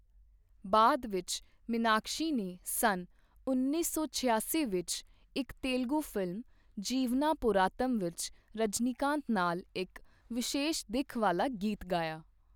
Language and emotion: Punjabi, neutral